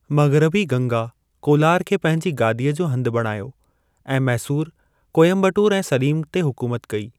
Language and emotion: Sindhi, neutral